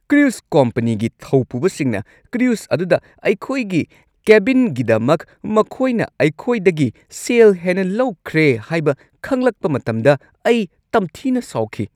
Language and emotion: Manipuri, angry